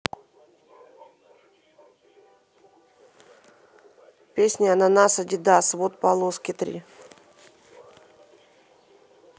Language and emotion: Russian, neutral